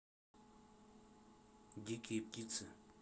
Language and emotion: Russian, neutral